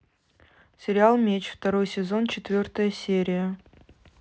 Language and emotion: Russian, neutral